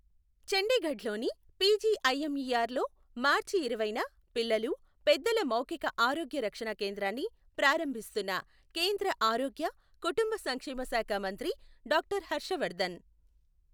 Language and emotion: Telugu, neutral